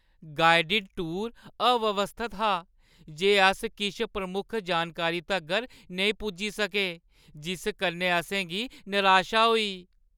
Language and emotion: Dogri, sad